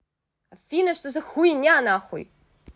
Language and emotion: Russian, angry